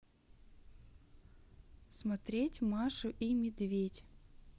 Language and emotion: Russian, neutral